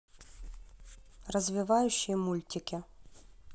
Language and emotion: Russian, neutral